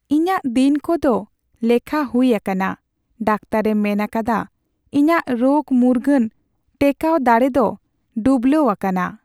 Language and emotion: Santali, sad